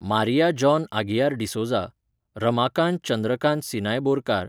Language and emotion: Goan Konkani, neutral